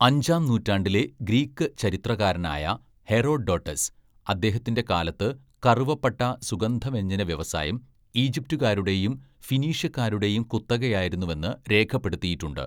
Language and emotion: Malayalam, neutral